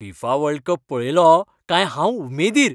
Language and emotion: Goan Konkani, happy